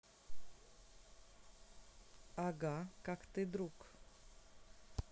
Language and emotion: Russian, neutral